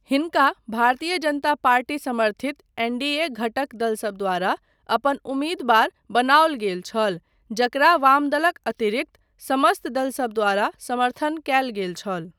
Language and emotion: Maithili, neutral